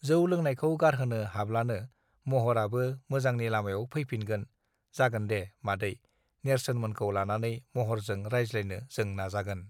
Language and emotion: Bodo, neutral